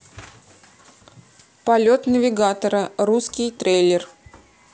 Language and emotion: Russian, neutral